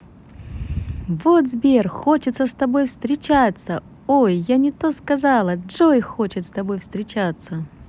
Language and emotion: Russian, positive